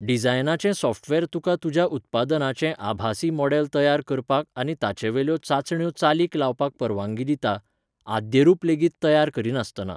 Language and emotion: Goan Konkani, neutral